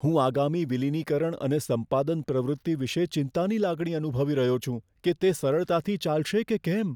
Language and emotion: Gujarati, fearful